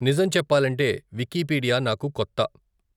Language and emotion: Telugu, neutral